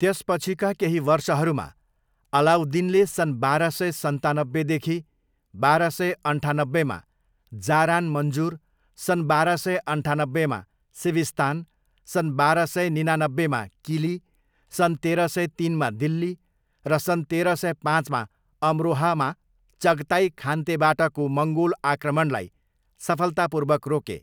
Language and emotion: Nepali, neutral